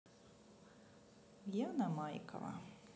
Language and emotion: Russian, neutral